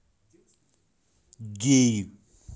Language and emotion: Russian, neutral